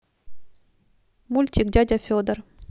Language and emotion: Russian, neutral